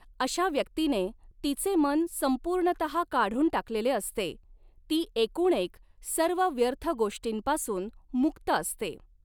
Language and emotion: Marathi, neutral